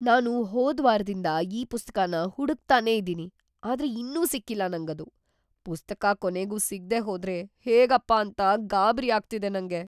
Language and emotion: Kannada, fearful